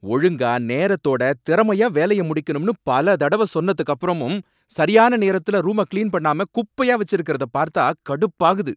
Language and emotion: Tamil, angry